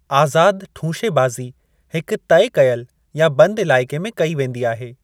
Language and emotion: Sindhi, neutral